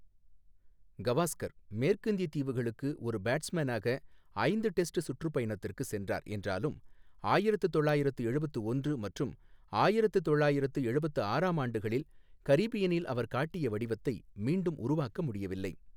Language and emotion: Tamil, neutral